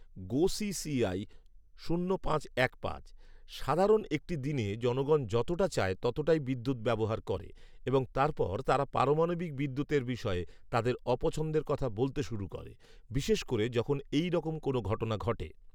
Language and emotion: Bengali, neutral